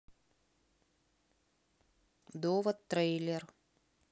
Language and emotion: Russian, neutral